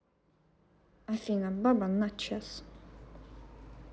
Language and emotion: Russian, neutral